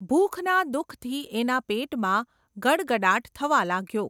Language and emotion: Gujarati, neutral